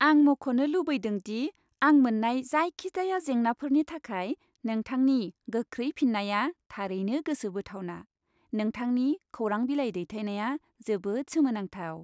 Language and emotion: Bodo, happy